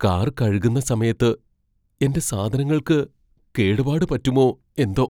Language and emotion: Malayalam, fearful